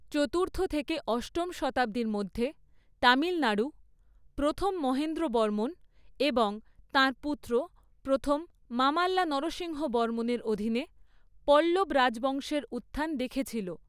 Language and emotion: Bengali, neutral